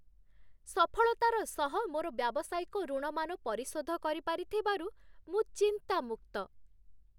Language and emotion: Odia, happy